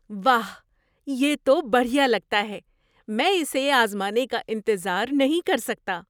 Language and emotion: Urdu, surprised